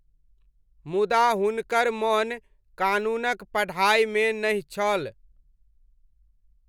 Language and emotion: Maithili, neutral